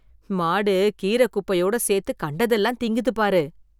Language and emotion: Tamil, disgusted